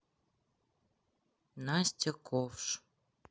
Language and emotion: Russian, neutral